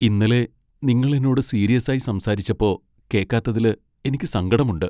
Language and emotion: Malayalam, sad